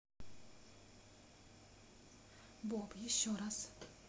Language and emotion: Russian, neutral